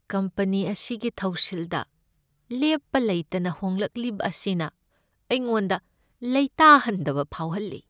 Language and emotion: Manipuri, sad